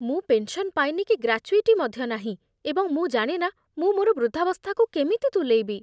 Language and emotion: Odia, fearful